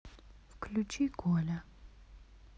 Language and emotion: Russian, neutral